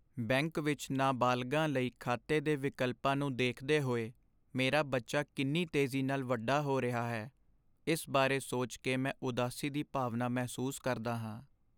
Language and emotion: Punjabi, sad